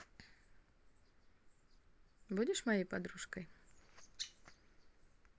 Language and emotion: Russian, positive